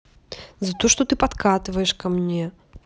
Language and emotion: Russian, neutral